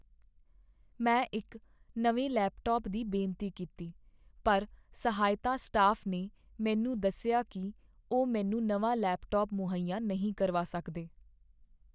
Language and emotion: Punjabi, sad